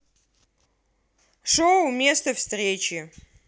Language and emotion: Russian, angry